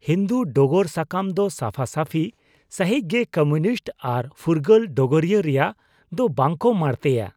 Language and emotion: Santali, disgusted